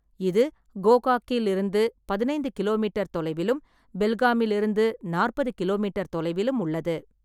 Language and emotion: Tamil, neutral